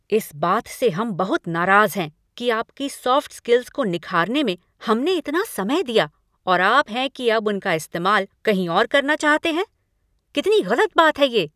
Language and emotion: Hindi, angry